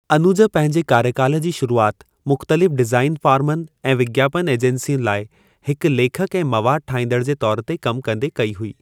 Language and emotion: Sindhi, neutral